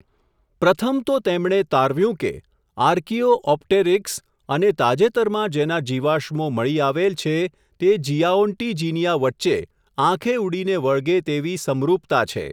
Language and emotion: Gujarati, neutral